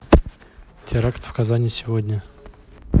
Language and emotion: Russian, neutral